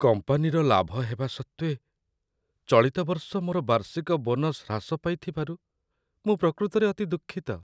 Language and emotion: Odia, sad